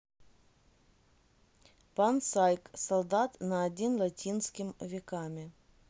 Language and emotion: Russian, neutral